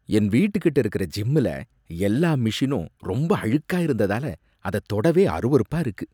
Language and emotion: Tamil, disgusted